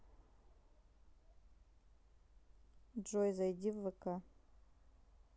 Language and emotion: Russian, neutral